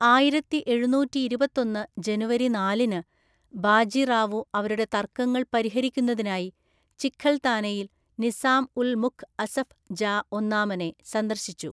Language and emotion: Malayalam, neutral